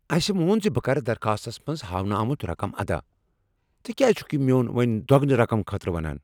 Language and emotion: Kashmiri, angry